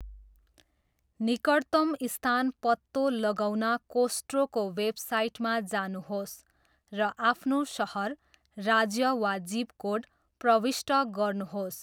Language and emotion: Nepali, neutral